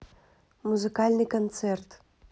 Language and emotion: Russian, neutral